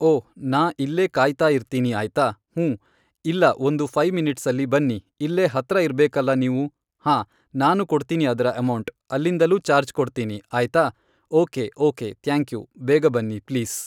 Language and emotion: Kannada, neutral